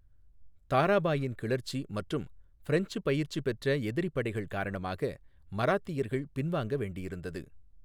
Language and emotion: Tamil, neutral